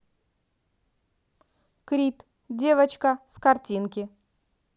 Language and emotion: Russian, neutral